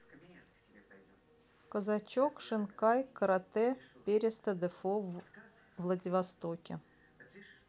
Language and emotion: Russian, neutral